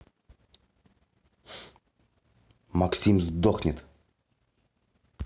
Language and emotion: Russian, angry